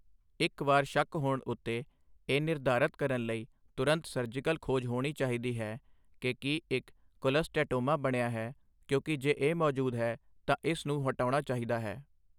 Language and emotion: Punjabi, neutral